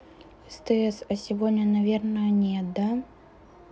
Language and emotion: Russian, neutral